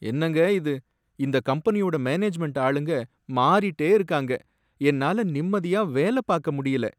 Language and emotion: Tamil, sad